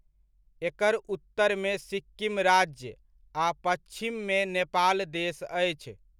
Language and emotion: Maithili, neutral